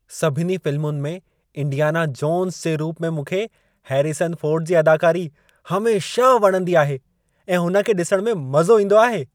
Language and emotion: Sindhi, happy